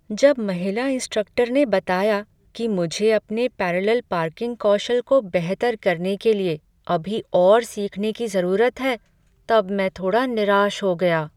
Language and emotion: Hindi, sad